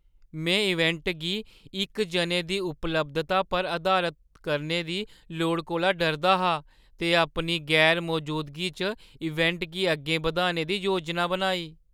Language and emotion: Dogri, fearful